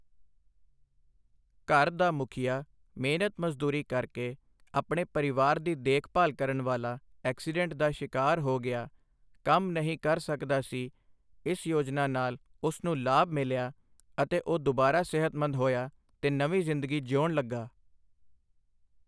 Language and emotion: Punjabi, neutral